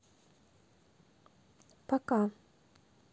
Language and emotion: Russian, neutral